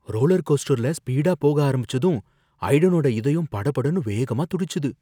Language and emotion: Tamil, fearful